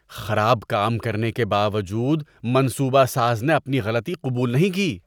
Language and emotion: Urdu, disgusted